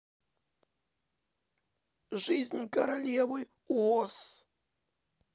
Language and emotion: Russian, neutral